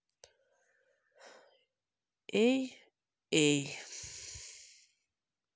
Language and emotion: Russian, sad